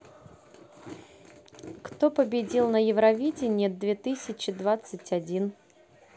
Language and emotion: Russian, neutral